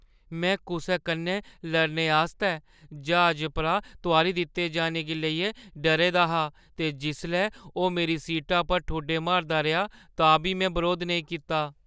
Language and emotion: Dogri, fearful